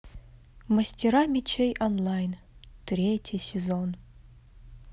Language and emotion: Russian, sad